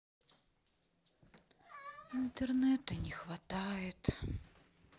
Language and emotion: Russian, sad